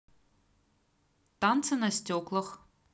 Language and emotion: Russian, neutral